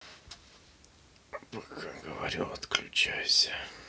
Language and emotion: Russian, neutral